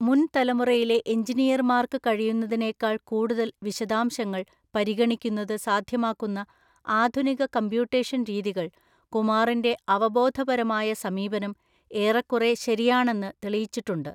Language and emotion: Malayalam, neutral